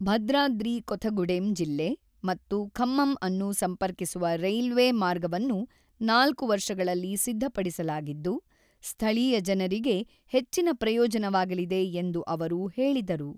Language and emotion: Kannada, neutral